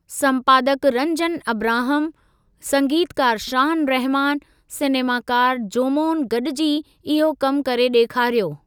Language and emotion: Sindhi, neutral